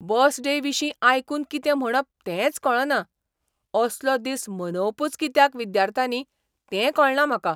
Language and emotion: Goan Konkani, surprised